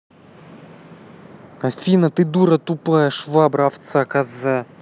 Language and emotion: Russian, angry